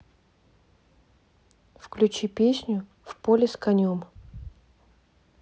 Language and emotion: Russian, neutral